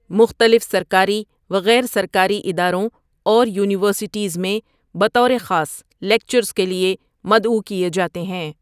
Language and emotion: Urdu, neutral